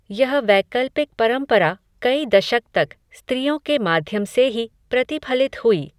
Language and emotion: Hindi, neutral